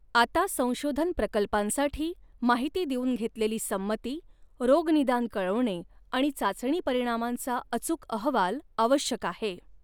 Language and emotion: Marathi, neutral